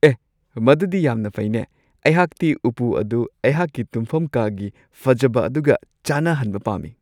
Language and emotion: Manipuri, happy